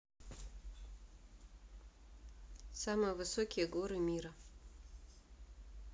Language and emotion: Russian, neutral